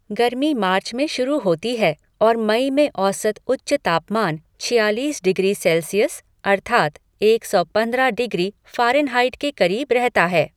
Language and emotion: Hindi, neutral